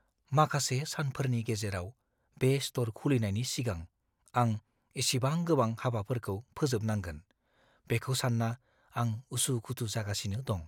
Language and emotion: Bodo, fearful